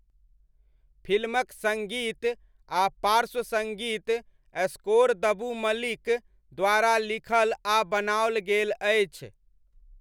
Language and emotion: Maithili, neutral